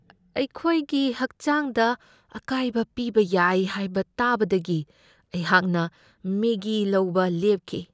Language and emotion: Manipuri, fearful